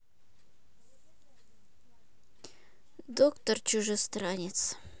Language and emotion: Russian, neutral